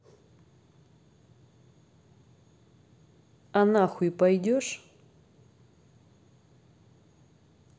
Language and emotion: Russian, angry